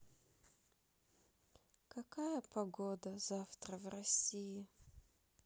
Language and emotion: Russian, sad